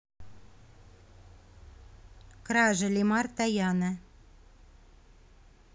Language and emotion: Russian, neutral